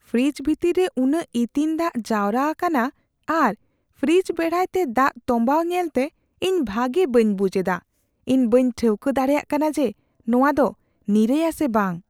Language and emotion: Santali, fearful